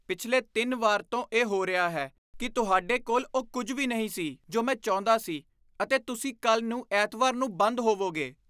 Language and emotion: Punjabi, disgusted